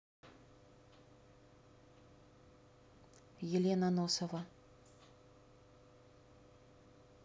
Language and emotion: Russian, neutral